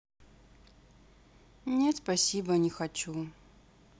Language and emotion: Russian, sad